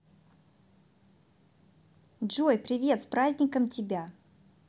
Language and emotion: Russian, positive